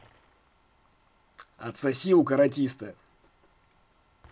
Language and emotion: Russian, angry